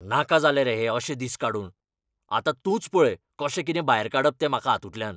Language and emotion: Goan Konkani, angry